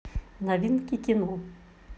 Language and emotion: Russian, neutral